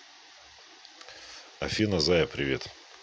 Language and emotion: Russian, positive